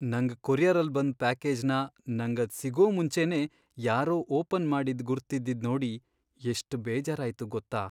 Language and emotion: Kannada, sad